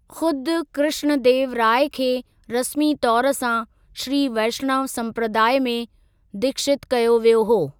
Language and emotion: Sindhi, neutral